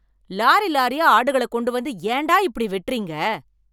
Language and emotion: Tamil, angry